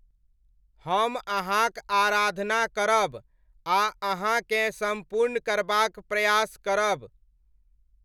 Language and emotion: Maithili, neutral